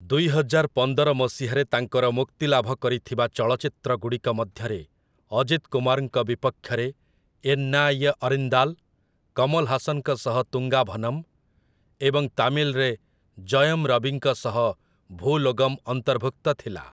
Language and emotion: Odia, neutral